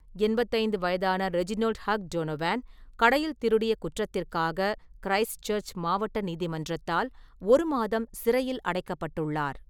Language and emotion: Tamil, neutral